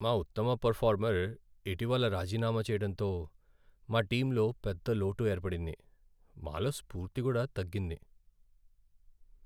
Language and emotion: Telugu, sad